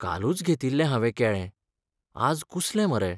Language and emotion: Goan Konkani, sad